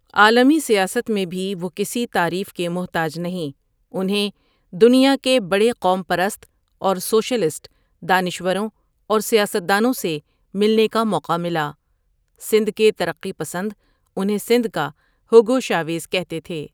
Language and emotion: Urdu, neutral